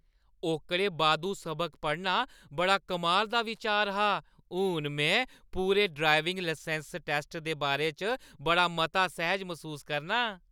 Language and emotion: Dogri, happy